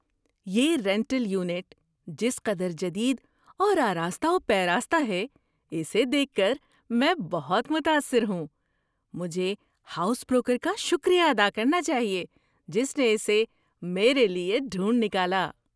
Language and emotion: Urdu, surprised